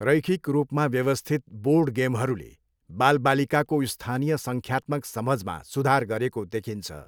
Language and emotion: Nepali, neutral